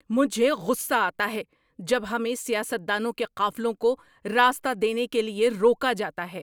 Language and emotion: Urdu, angry